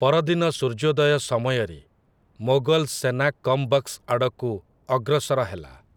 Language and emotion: Odia, neutral